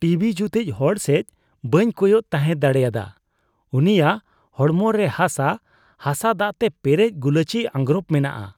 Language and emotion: Santali, disgusted